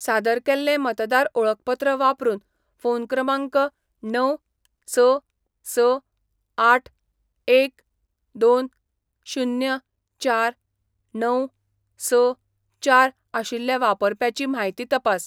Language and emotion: Goan Konkani, neutral